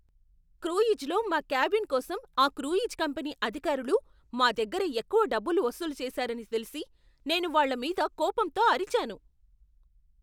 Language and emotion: Telugu, angry